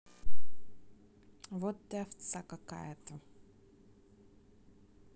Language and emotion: Russian, neutral